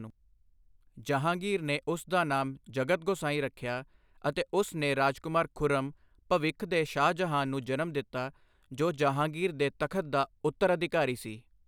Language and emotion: Punjabi, neutral